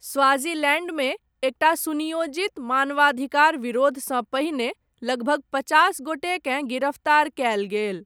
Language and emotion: Maithili, neutral